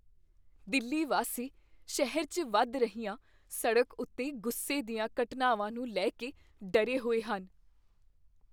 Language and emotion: Punjabi, fearful